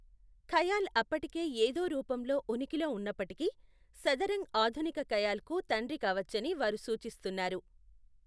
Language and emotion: Telugu, neutral